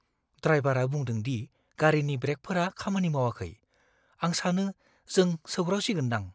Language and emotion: Bodo, fearful